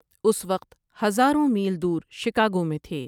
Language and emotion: Urdu, neutral